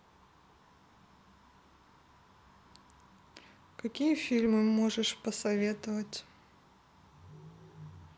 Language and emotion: Russian, neutral